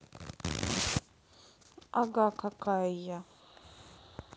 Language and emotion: Russian, neutral